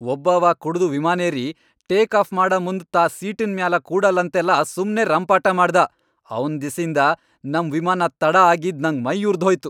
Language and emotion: Kannada, angry